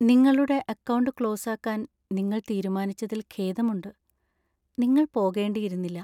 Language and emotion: Malayalam, sad